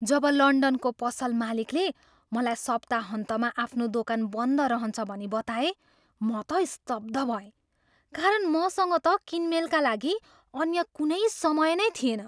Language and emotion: Nepali, surprised